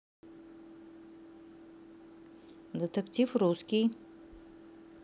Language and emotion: Russian, neutral